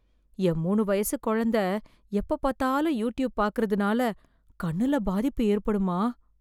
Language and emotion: Tamil, fearful